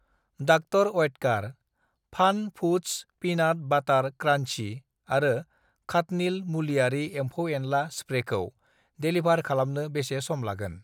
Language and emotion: Bodo, neutral